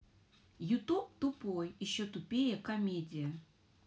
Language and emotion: Russian, angry